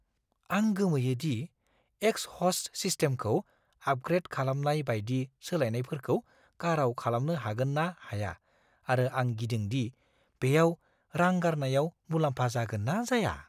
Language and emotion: Bodo, fearful